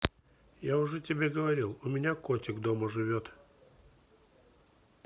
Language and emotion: Russian, neutral